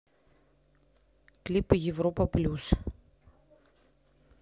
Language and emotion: Russian, neutral